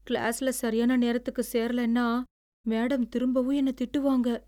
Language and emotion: Tamil, fearful